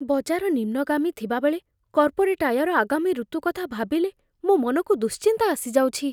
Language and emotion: Odia, fearful